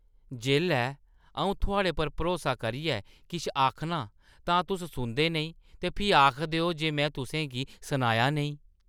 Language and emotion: Dogri, disgusted